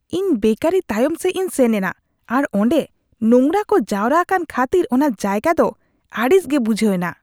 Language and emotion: Santali, disgusted